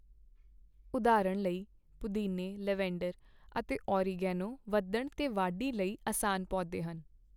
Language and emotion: Punjabi, neutral